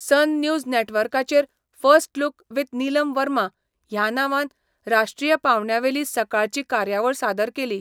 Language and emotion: Goan Konkani, neutral